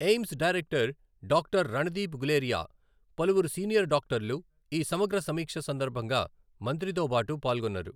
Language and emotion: Telugu, neutral